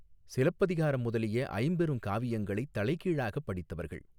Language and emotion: Tamil, neutral